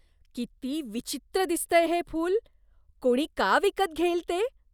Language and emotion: Marathi, disgusted